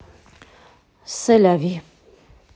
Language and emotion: Russian, neutral